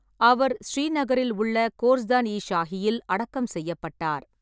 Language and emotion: Tamil, neutral